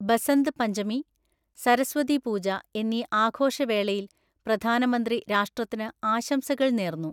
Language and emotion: Malayalam, neutral